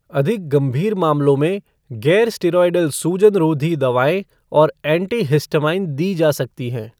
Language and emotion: Hindi, neutral